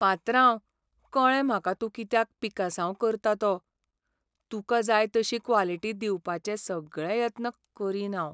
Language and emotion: Goan Konkani, sad